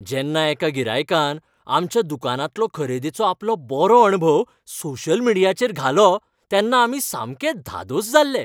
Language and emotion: Goan Konkani, happy